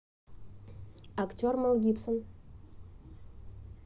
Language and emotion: Russian, neutral